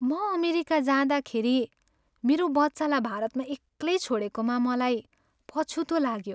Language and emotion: Nepali, sad